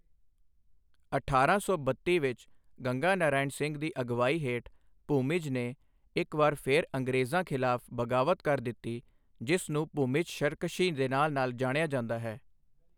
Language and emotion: Punjabi, neutral